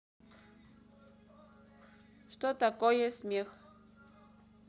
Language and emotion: Russian, neutral